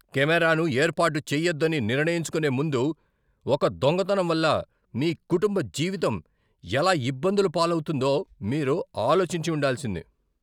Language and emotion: Telugu, angry